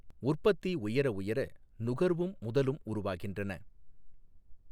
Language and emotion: Tamil, neutral